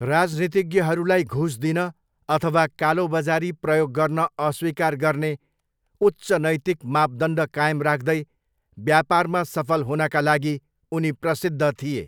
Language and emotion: Nepali, neutral